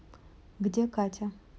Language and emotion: Russian, neutral